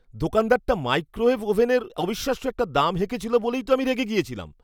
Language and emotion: Bengali, angry